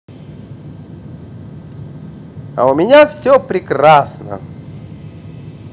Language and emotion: Russian, positive